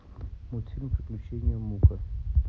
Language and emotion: Russian, neutral